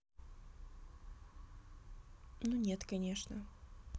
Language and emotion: Russian, neutral